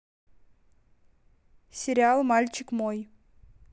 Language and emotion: Russian, neutral